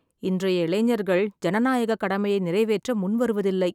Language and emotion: Tamil, sad